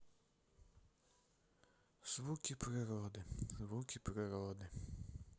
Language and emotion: Russian, sad